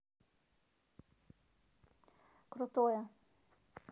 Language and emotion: Russian, neutral